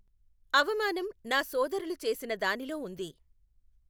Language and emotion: Telugu, neutral